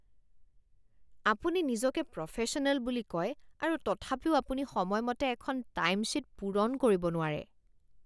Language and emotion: Assamese, disgusted